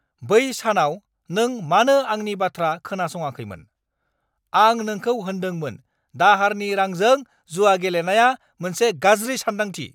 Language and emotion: Bodo, angry